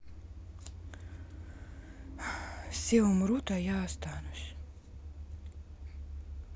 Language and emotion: Russian, sad